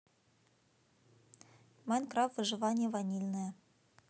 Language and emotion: Russian, neutral